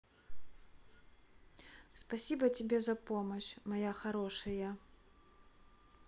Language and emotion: Russian, neutral